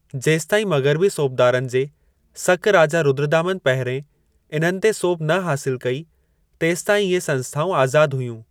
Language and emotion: Sindhi, neutral